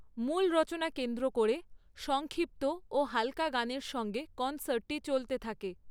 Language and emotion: Bengali, neutral